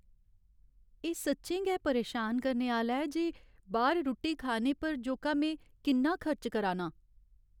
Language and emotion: Dogri, sad